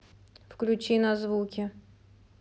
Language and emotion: Russian, neutral